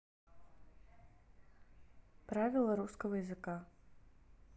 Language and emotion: Russian, neutral